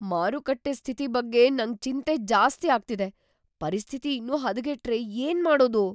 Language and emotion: Kannada, fearful